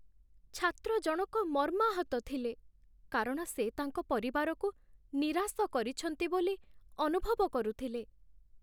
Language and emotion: Odia, sad